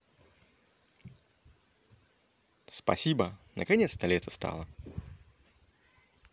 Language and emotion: Russian, positive